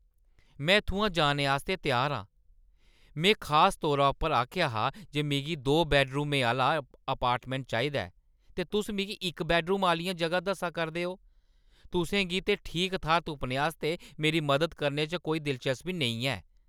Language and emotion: Dogri, angry